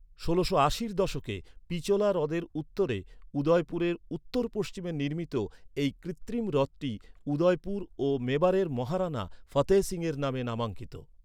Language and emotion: Bengali, neutral